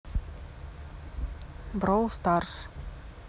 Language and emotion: Russian, neutral